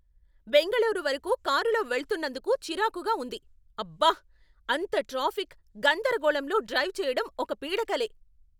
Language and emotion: Telugu, angry